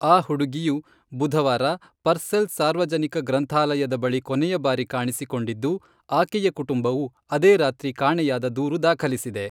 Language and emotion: Kannada, neutral